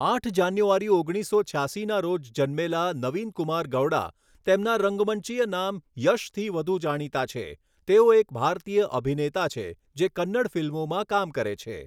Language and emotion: Gujarati, neutral